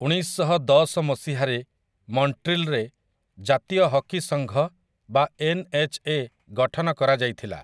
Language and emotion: Odia, neutral